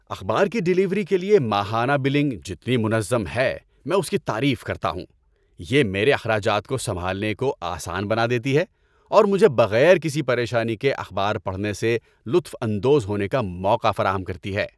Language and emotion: Urdu, happy